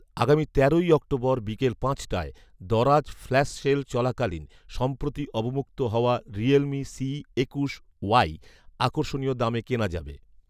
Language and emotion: Bengali, neutral